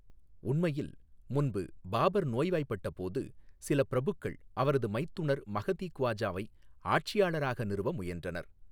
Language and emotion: Tamil, neutral